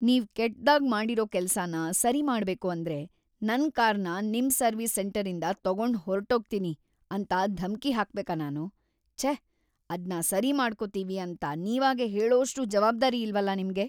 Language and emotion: Kannada, disgusted